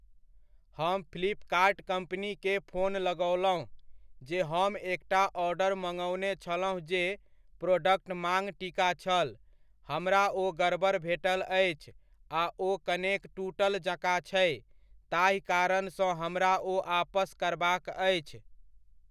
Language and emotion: Maithili, neutral